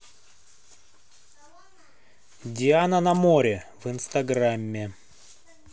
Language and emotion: Russian, neutral